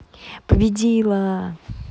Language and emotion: Russian, positive